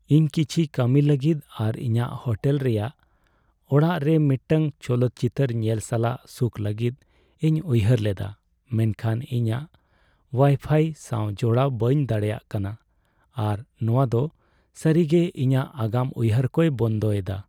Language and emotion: Santali, sad